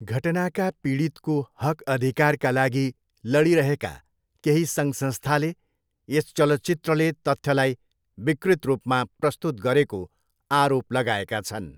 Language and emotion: Nepali, neutral